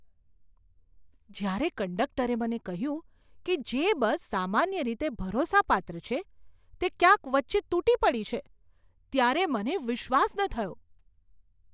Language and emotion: Gujarati, surprised